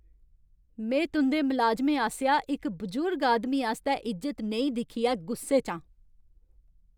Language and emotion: Dogri, angry